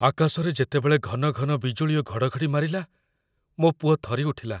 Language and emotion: Odia, fearful